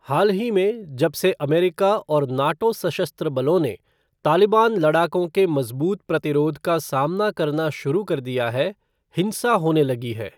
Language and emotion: Hindi, neutral